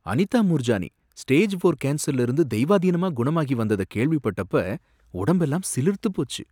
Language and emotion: Tamil, surprised